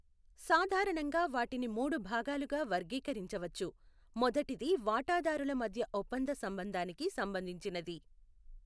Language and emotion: Telugu, neutral